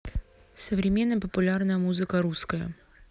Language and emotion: Russian, neutral